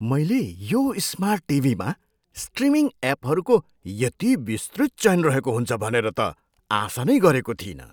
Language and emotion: Nepali, surprised